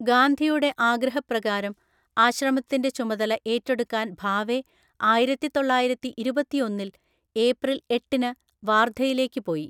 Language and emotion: Malayalam, neutral